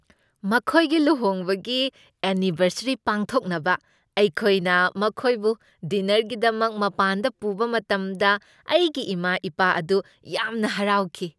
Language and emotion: Manipuri, happy